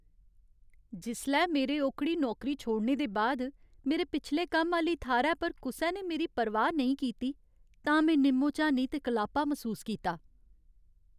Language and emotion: Dogri, sad